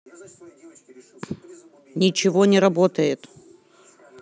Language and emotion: Russian, angry